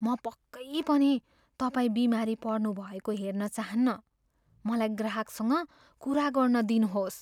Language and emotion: Nepali, fearful